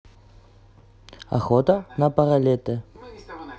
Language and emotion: Russian, neutral